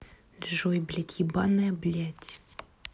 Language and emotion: Russian, angry